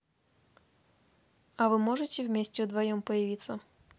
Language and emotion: Russian, neutral